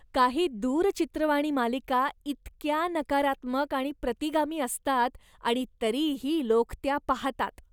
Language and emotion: Marathi, disgusted